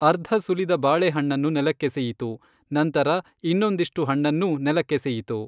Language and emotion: Kannada, neutral